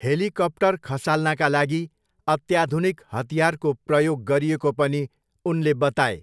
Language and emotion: Nepali, neutral